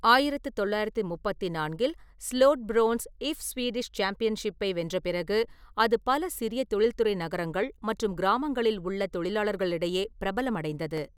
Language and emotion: Tamil, neutral